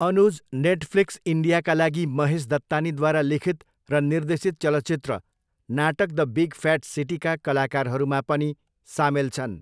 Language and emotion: Nepali, neutral